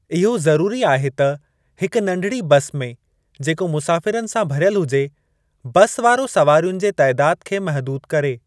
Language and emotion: Sindhi, neutral